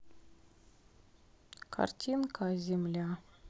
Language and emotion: Russian, sad